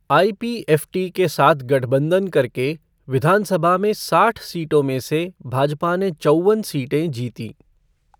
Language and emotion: Hindi, neutral